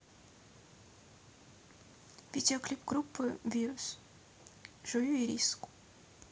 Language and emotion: Russian, neutral